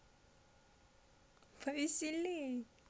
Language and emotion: Russian, positive